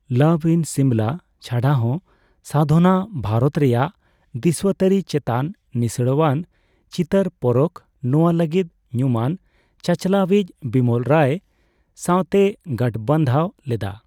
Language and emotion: Santali, neutral